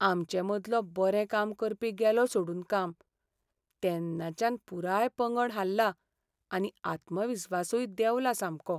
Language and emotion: Goan Konkani, sad